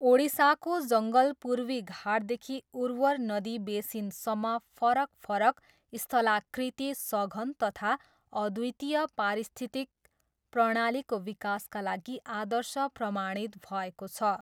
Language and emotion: Nepali, neutral